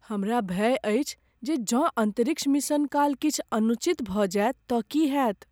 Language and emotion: Maithili, fearful